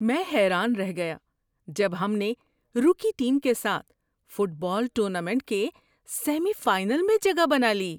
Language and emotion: Urdu, surprised